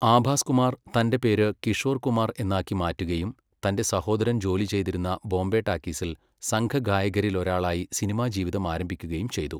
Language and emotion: Malayalam, neutral